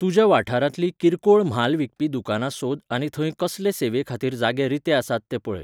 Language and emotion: Goan Konkani, neutral